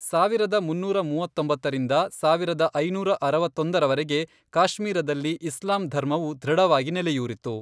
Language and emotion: Kannada, neutral